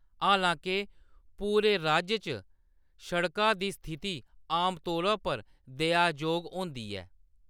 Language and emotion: Dogri, neutral